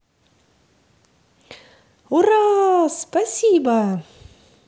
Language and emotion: Russian, positive